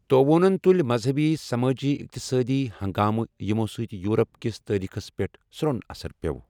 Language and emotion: Kashmiri, neutral